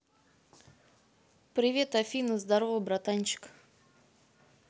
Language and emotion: Russian, neutral